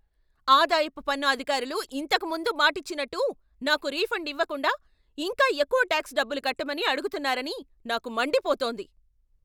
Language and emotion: Telugu, angry